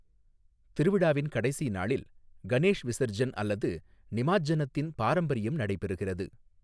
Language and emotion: Tamil, neutral